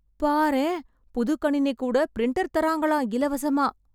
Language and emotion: Tamil, surprised